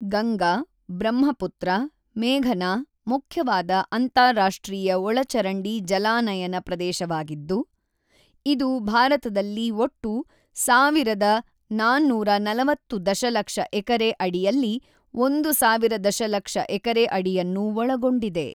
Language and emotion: Kannada, neutral